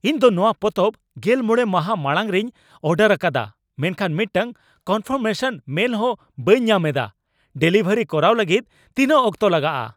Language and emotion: Santali, angry